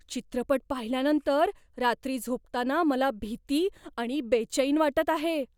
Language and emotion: Marathi, fearful